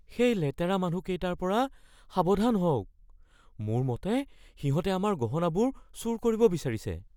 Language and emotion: Assamese, fearful